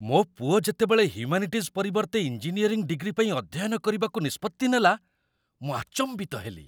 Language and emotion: Odia, surprised